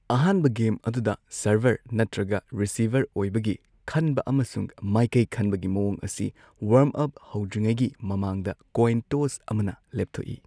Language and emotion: Manipuri, neutral